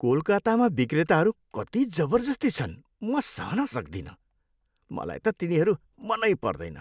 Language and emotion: Nepali, disgusted